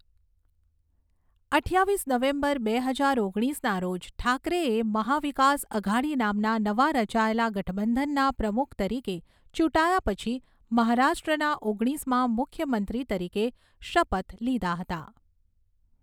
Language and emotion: Gujarati, neutral